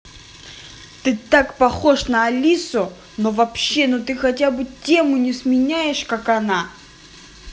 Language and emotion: Russian, angry